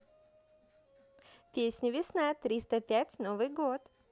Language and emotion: Russian, positive